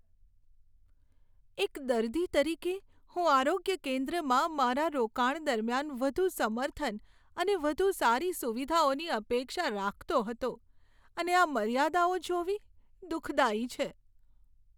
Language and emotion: Gujarati, sad